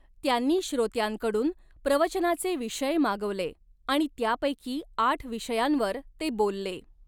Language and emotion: Marathi, neutral